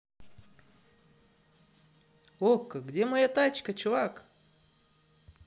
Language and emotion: Russian, neutral